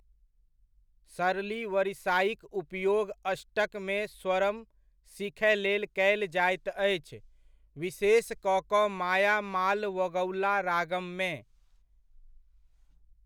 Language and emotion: Maithili, neutral